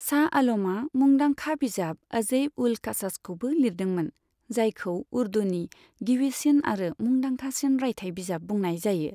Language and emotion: Bodo, neutral